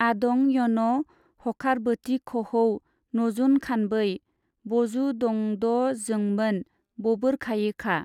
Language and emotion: Bodo, neutral